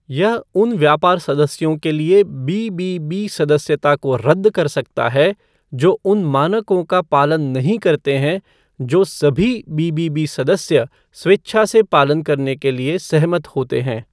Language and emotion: Hindi, neutral